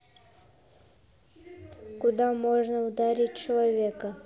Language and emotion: Russian, neutral